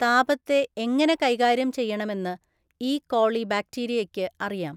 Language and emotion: Malayalam, neutral